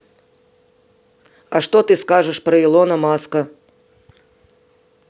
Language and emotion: Russian, neutral